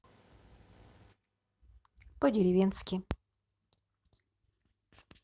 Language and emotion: Russian, neutral